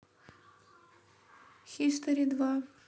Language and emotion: Russian, neutral